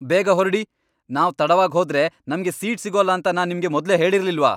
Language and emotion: Kannada, angry